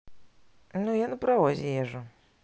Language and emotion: Russian, neutral